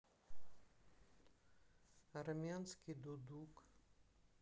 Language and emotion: Russian, sad